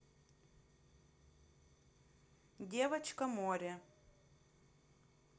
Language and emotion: Russian, neutral